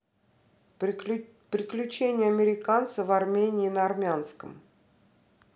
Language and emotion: Russian, neutral